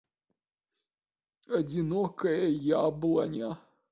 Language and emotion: Russian, sad